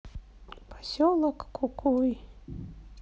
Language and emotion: Russian, sad